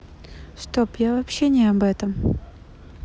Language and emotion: Russian, sad